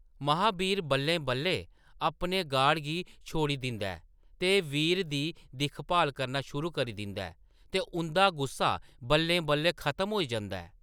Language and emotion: Dogri, neutral